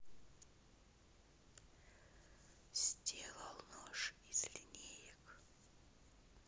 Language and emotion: Russian, neutral